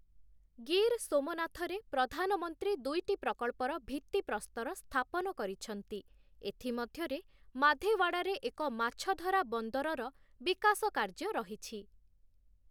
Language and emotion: Odia, neutral